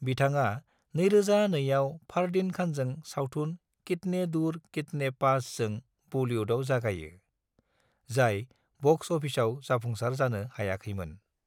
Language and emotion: Bodo, neutral